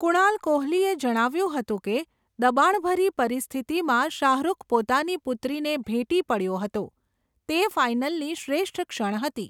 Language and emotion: Gujarati, neutral